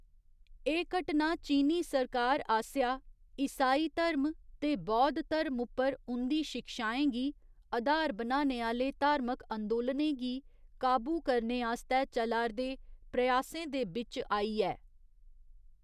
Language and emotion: Dogri, neutral